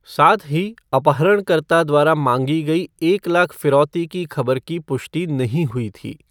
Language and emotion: Hindi, neutral